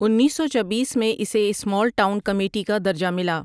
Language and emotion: Urdu, neutral